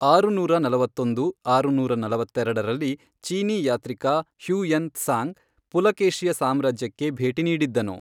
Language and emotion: Kannada, neutral